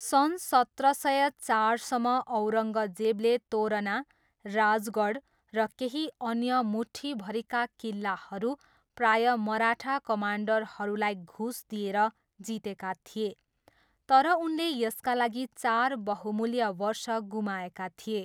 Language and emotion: Nepali, neutral